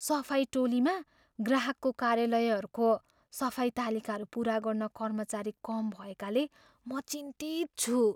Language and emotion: Nepali, fearful